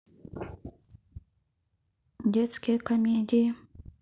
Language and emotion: Russian, neutral